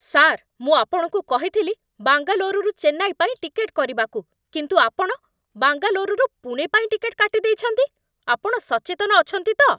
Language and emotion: Odia, angry